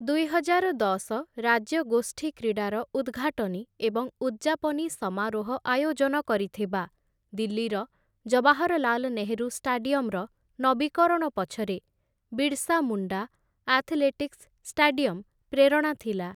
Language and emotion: Odia, neutral